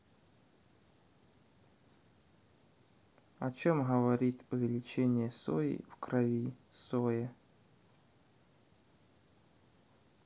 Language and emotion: Russian, neutral